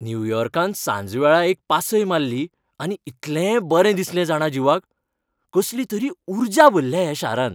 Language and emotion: Goan Konkani, happy